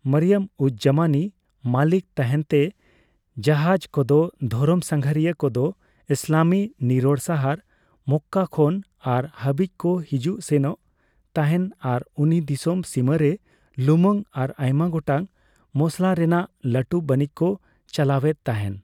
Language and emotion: Santali, neutral